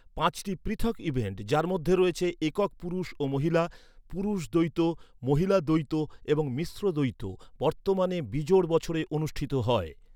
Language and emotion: Bengali, neutral